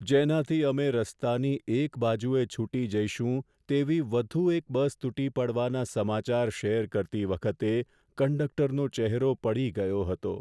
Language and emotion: Gujarati, sad